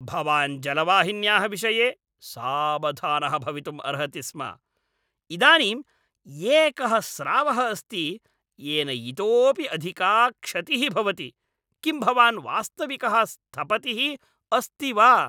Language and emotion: Sanskrit, angry